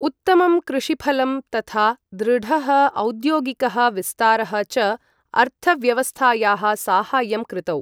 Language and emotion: Sanskrit, neutral